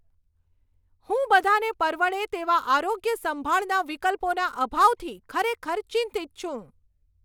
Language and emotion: Gujarati, angry